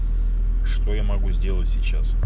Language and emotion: Russian, neutral